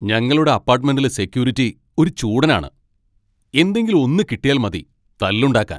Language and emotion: Malayalam, angry